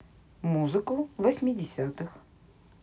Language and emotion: Russian, neutral